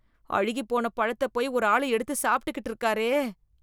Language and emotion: Tamil, disgusted